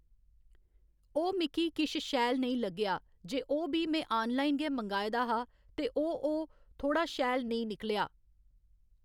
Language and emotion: Dogri, neutral